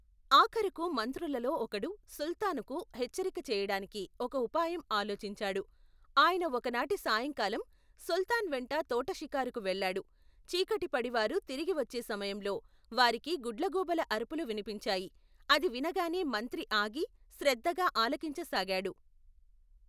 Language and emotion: Telugu, neutral